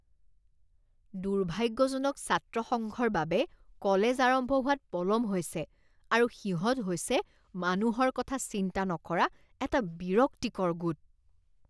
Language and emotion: Assamese, disgusted